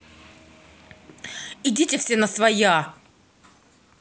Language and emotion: Russian, angry